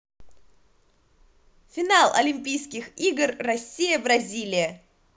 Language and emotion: Russian, positive